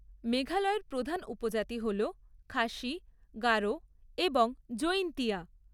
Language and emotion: Bengali, neutral